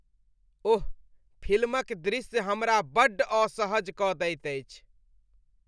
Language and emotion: Maithili, disgusted